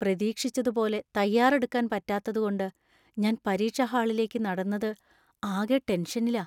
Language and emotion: Malayalam, fearful